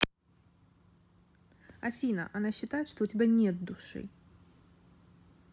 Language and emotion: Russian, neutral